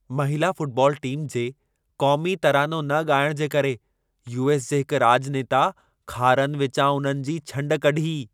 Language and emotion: Sindhi, angry